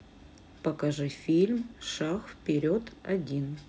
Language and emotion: Russian, neutral